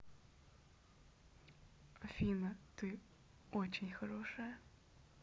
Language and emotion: Russian, neutral